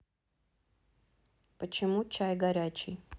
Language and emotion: Russian, neutral